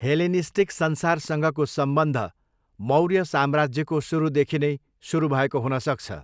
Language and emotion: Nepali, neutral